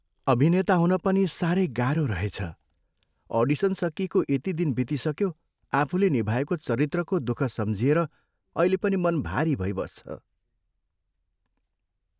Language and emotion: Nepali, sad